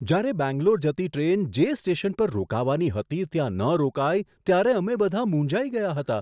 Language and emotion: Gujarati, surprised